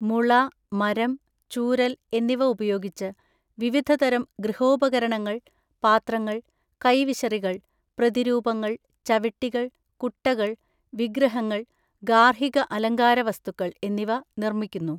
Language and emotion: Malayalam, neutral